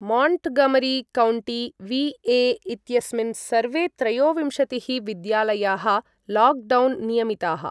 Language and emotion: Sanskrit, neutral